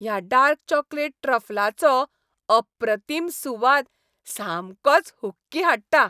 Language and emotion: Goan Konkani, happy